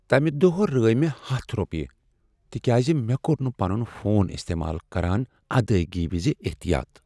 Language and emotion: Kashmiri, sad